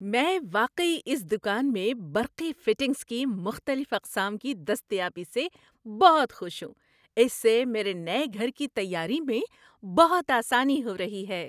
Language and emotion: Urdu, happy